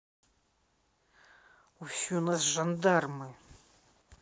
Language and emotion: Russian, neutral